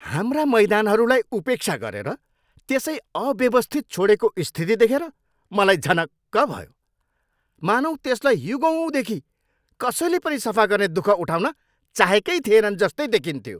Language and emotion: Nepali, angry